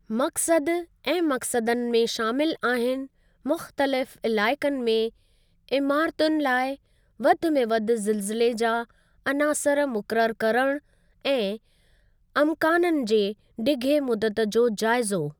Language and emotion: Sindhi, neutral